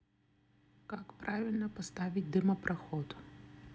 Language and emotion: Russian, neutral